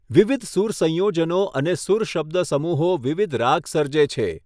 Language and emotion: Gujarati, neutral